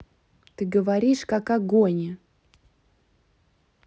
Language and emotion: Russian, neutral